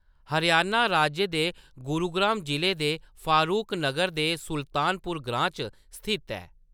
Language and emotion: Dogri, neutral